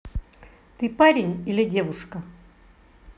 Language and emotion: Russian, angry